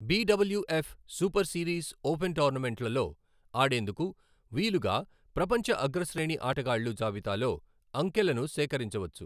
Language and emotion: Telugu, neutral